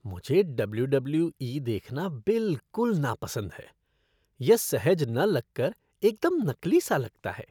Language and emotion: Hindi, disgusted